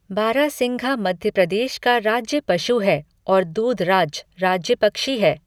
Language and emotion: Hindi, neutral